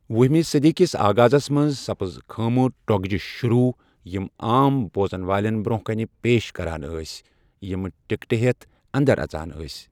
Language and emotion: Kashmiri, neutral